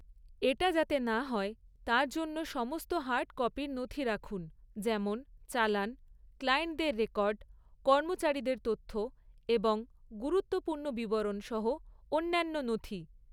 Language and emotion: Bengali, neutral